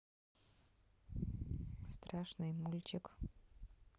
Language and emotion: Russian, neutral